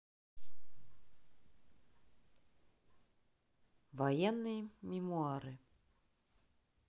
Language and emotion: Russian, neutral